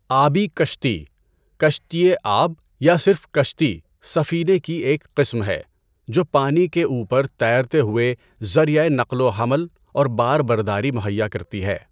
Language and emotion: Urdu, neutral